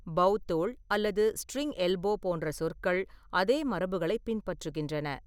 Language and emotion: Tamil, neutral